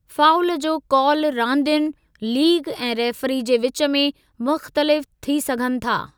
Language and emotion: Sindhi, neutral